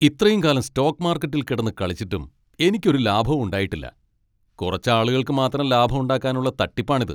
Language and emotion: Malayalam, angry